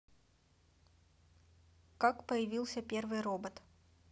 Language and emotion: Russian, neutral